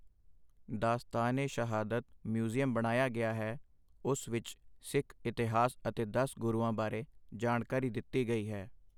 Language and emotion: Punjabi, neutral